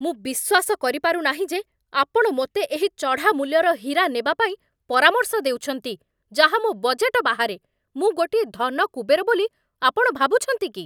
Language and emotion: Odia, angry